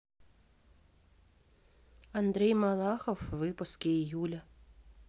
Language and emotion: Russian, neutral